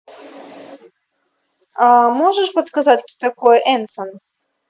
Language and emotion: Russian, neutral